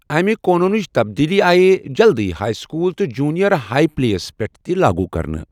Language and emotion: Kashmiri, neutral